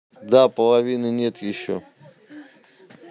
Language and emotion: Russian, neutral